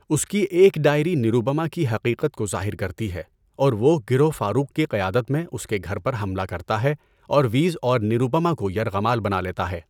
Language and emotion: Urdu, neutral